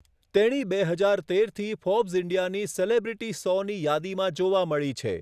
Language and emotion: Gujarati, neutral